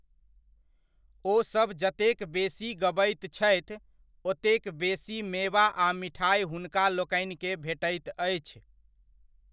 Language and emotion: Maithili, neutral